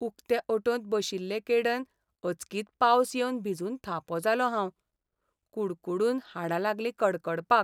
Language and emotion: Goan Konkani, sad